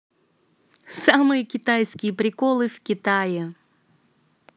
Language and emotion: Russian, positive